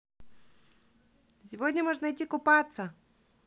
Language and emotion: Russian, positive